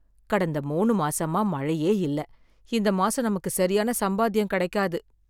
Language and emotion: Tamil, sad